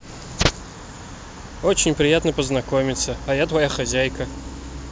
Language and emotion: Russian, neutral